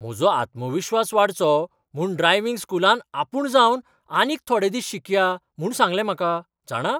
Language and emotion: Goan Konkani, surprised